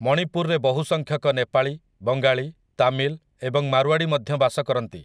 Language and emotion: Odia, neutral